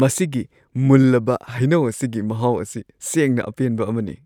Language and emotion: Manipuri, happy